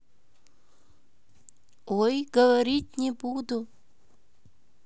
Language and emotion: Russian, positive